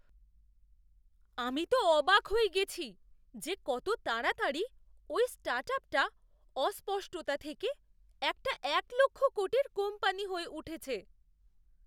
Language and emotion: Bengali, surprised